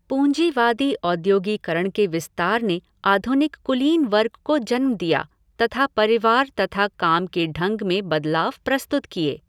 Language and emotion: Hindi, neutral